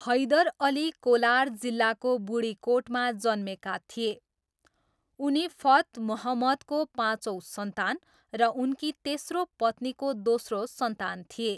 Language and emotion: Nepali, neutral